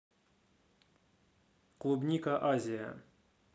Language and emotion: Russian, neutral